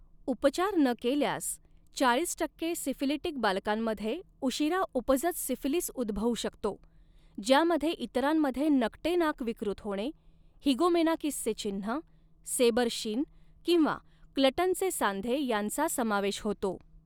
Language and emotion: Marathi, neutral